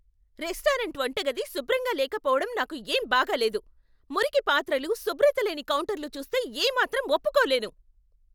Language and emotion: Telugu, angry